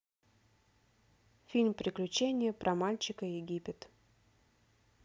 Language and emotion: Russian, neutral